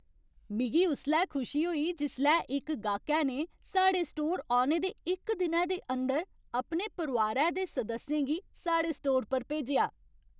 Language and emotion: Dogri, happy